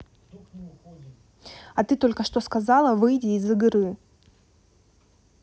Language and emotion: Russian, angry